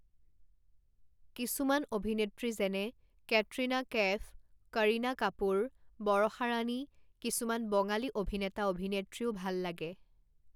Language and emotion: Assamese, neutral